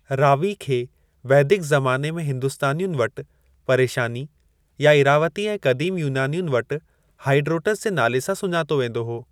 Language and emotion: Sindhi, neutral